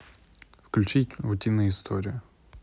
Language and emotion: Russian, neutral